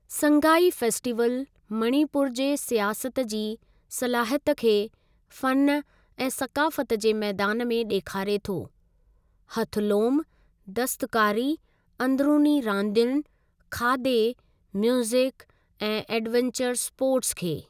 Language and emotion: Sindhi, neutral